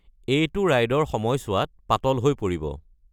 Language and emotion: Assamese, neutral